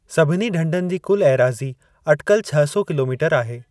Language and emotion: Sindhi, neutral